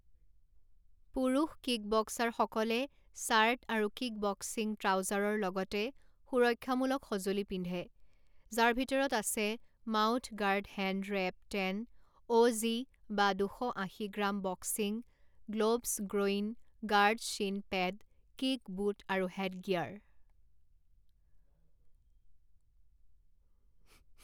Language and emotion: Assamese, neutral